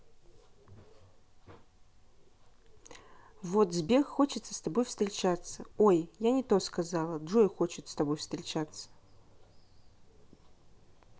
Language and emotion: Russian, neutral